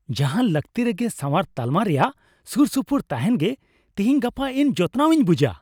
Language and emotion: Santali, happy